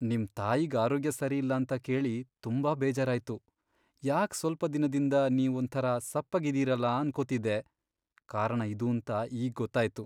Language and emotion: Kannada, sad